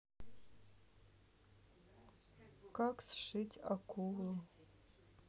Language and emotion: Russian, sad